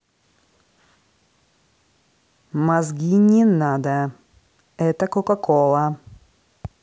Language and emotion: Russian, neutral